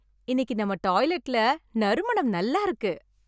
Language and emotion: Tamil, happy